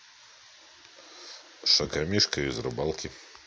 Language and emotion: Russian, neutral